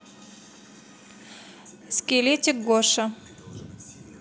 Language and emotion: Russian, neutral